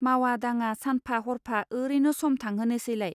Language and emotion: Bodo, neutral